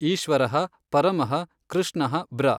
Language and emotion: Kannada, neutral